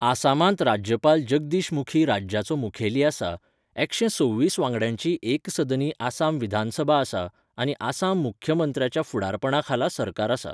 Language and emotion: Goan Konkani, neutral